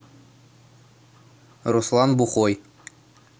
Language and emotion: Russian, neutral